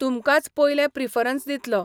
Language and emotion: Goan Konkani, neutral